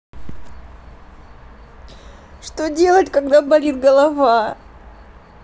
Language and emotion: Russian, sad